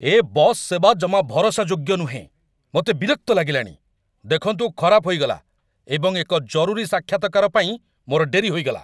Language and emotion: Odia, angry